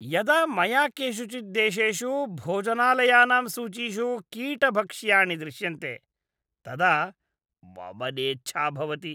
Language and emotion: Sanskrit, disgusted